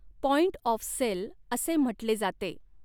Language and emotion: Marathi, neutral